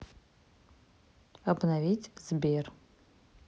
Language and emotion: Russian, neutral